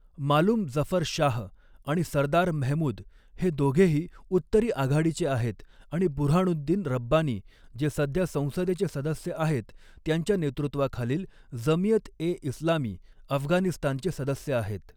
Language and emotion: Marathi, neutral